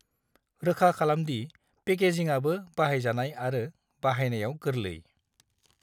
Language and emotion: Bodo, neutral